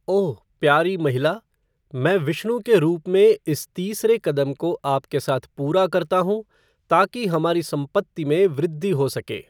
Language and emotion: Hindi, neutral